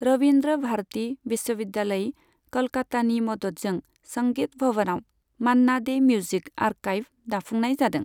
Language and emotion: Bodo, neutral